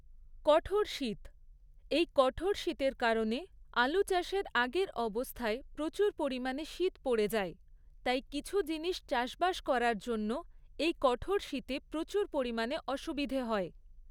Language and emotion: Bengali, neutral